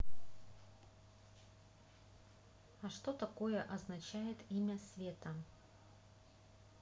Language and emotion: Russian, neutral